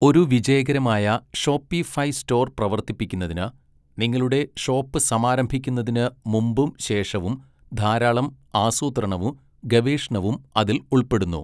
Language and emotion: Malayalam, neutral